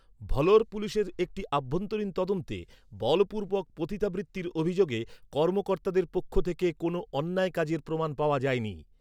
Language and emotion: Bengali, neutral